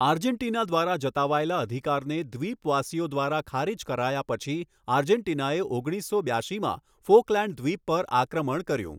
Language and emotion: Gujarati, neutral